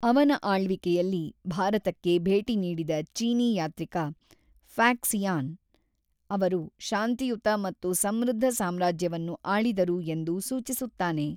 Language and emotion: Kannada, neutral